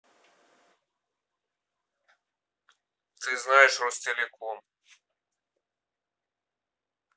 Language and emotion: Russian, neutral